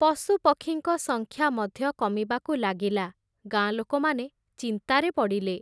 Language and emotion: Odia, neutral